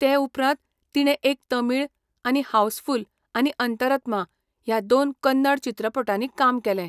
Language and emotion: Goan Konkani, neutral